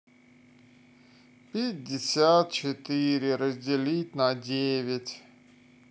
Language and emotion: Russian, sad